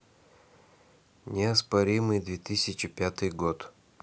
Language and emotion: Russian, neutral